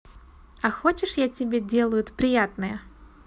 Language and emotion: Russian, positive